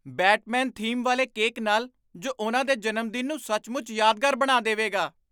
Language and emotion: Punjabi, surprised